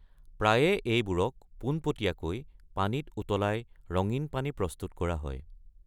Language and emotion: Assamese, neutral